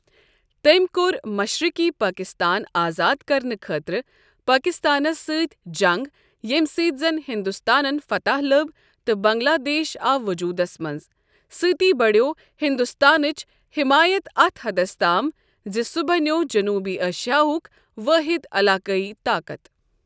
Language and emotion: Kashmiri, neutral